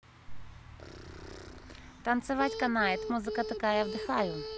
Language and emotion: Russian, positive